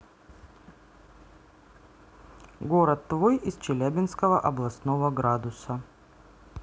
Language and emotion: Russian, neutral